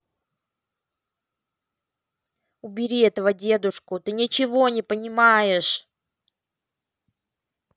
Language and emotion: Russian, angry